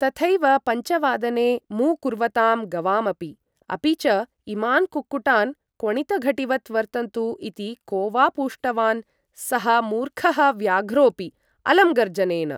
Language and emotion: Sanskrit, neutral